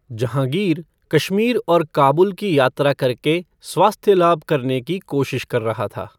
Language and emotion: Hindi, neutral